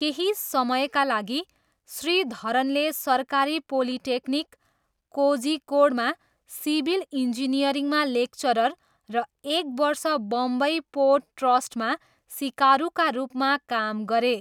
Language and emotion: Nepali, neutral